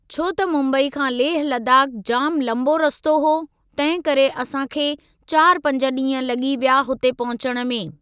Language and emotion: Sindhi, neutral